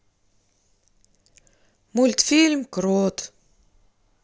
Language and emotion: Russian, sad